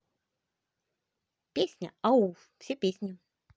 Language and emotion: Russian, positive